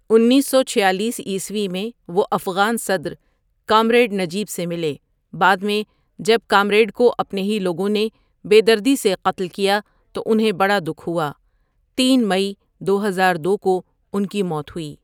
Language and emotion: Urdu, neutral